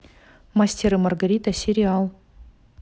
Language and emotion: Russian, neutral